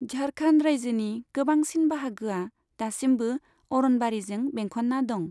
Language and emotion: Bodo, neutral